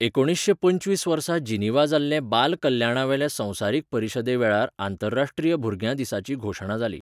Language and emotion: Goan Konkani, neutral